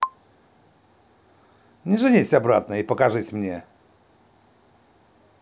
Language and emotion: Russian, positive